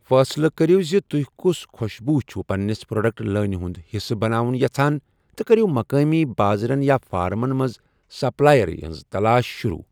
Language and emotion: Kashmiri, neutral